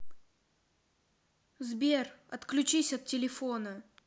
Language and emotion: Russian, angry